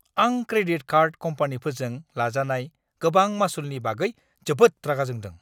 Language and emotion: Bodo, angry